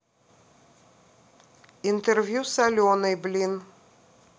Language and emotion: Russian, neutral